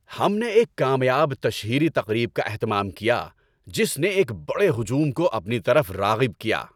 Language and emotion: Urdu, happy